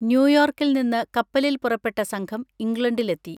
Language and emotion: Malayalam, neutral